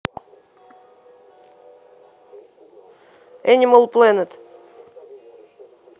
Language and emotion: Russian, neutral